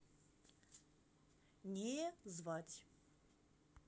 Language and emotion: Russian, neutral